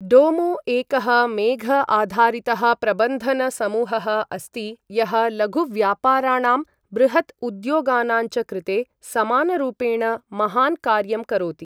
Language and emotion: Sanskrit, neutral